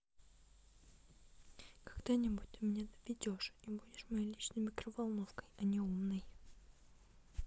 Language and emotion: Russian, neutral